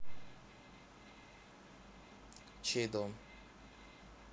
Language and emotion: Russian, neutral